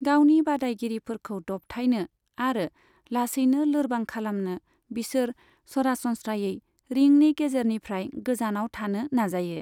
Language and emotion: Bodo, neutral